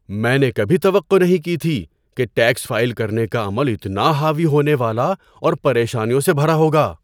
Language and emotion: Urdu, surprised